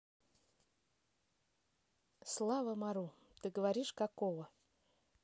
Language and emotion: Russian, neutral